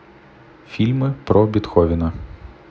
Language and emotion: Russian, neutral